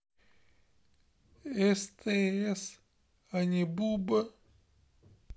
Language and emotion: Russian, sad